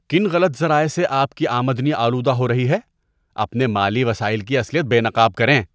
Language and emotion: Urdu, disgusted